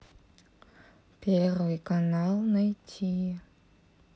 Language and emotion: Russian, neutral